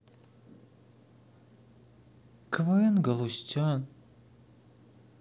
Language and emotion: Russian, sad